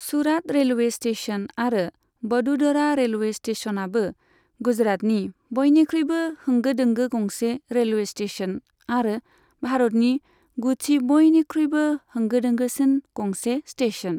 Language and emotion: Bodo, neutral